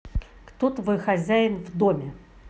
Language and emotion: Russian, angry